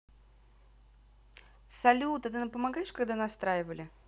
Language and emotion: Russian, positive